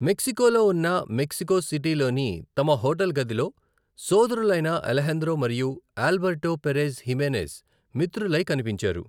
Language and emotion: Telugu, neutral